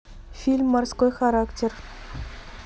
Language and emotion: Russian, neutral